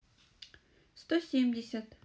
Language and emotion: Russian, neutral